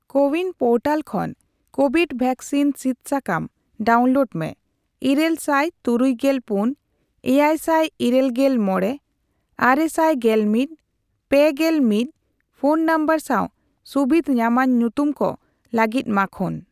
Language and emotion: Santali, neutral